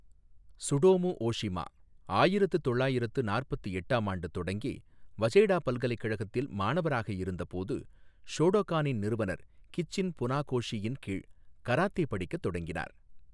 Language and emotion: Tamil, neutral